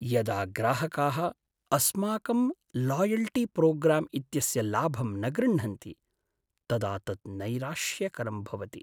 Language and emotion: Sanskrit, sad